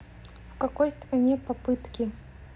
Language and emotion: Russian, neutral